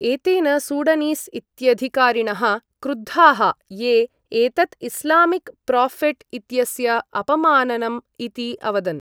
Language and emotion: Sanskrit, neutral